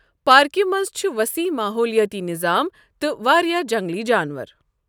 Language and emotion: Kashmiri, neutral